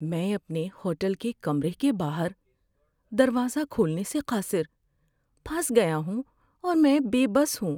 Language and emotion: Urdu, sad